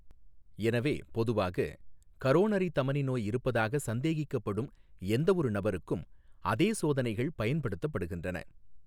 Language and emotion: Tamil, neutral